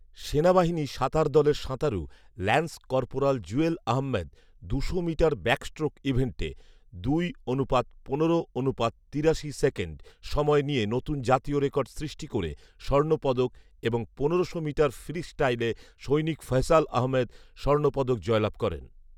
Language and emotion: Bengali, neutral